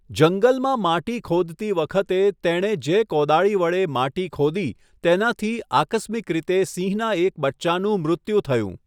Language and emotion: Gujarati, neutral